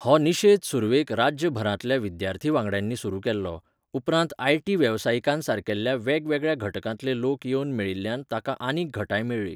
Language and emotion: Goan Konkani, neutral